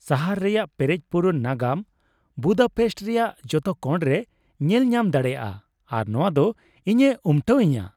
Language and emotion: Santali, happy